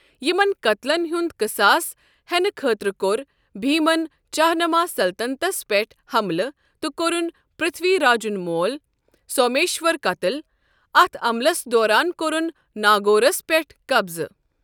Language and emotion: Kashmiri, neutral